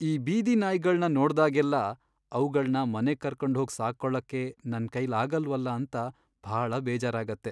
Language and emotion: Kannada, sad